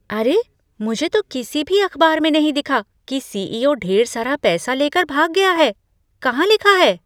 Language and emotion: Hindi, surprised